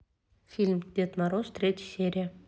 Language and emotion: Russian, neutral